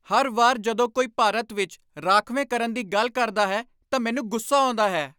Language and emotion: Punjabi, angry